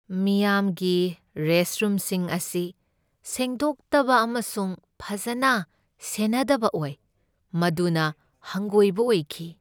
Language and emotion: Manipuri, sad